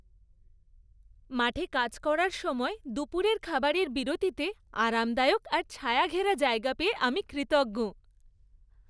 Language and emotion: Bengali, happy